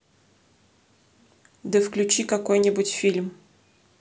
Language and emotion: Russian, neutral